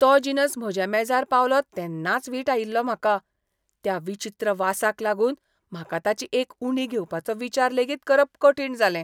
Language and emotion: Goan Konkani, disgusted